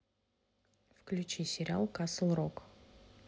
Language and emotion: Russian, neutral